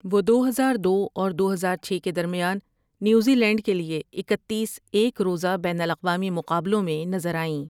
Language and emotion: Urdu, neutral